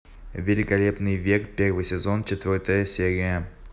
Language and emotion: Russian, neutral